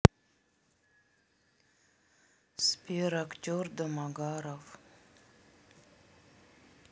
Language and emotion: Russian, sad